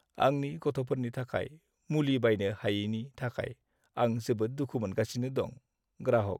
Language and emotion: Bodo, sad